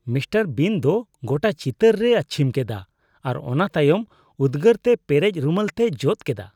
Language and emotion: Santali, disgusted